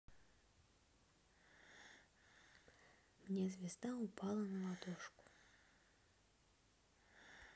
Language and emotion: Russian, neutral